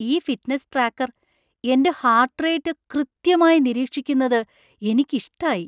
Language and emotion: Malayalam, surprised